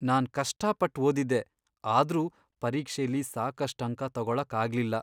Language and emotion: Kannada, sad